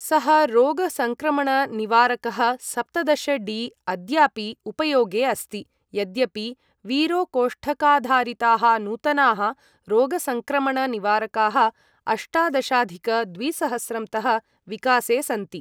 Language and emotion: Sanskrit, neutral